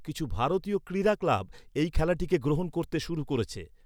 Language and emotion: Bengali, neutral